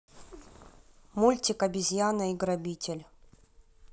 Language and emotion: Russian, neutral